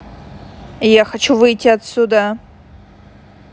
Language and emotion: Russian, angry